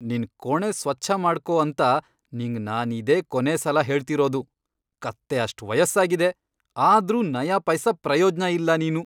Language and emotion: Kannada, angry